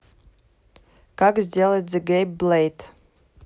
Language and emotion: Russian, neutral